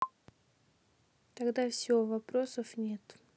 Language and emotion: Russian, neutral